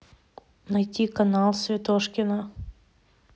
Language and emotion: Russian, neutral